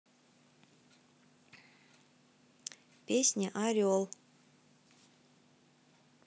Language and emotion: Russian, neutral